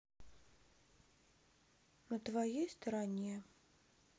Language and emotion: Russian, sad